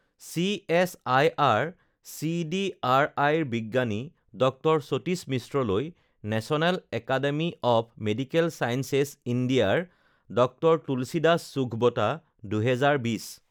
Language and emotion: Assamese, neutral